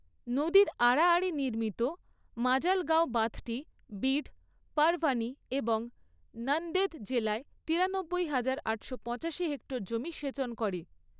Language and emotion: Bengali, neutral